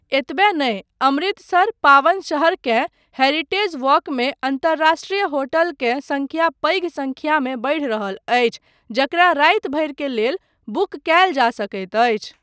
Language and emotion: Maithili, neutral